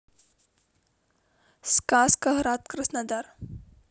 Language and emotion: Russian, neutral